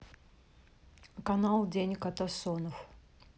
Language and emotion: Russian, neutral